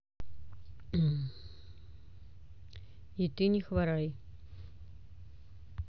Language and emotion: Russian, neutral